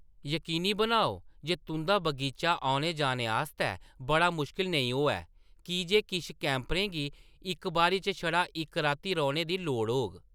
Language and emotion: Dogri, neutral